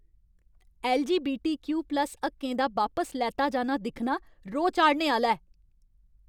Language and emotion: Dogri, angry